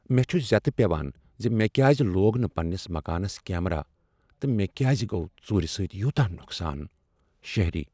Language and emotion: Kashmiri, sad